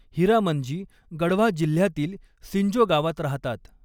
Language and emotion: Marathi, neutral